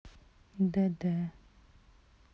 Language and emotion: Russian, neutral